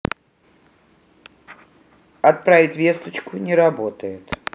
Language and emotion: Russian, neutral